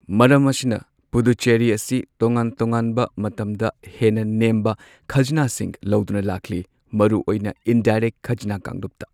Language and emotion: Manipuri, neutral